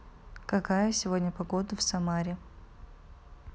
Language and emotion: Russian, neutral